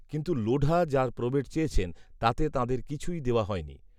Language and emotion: Bengali, neutral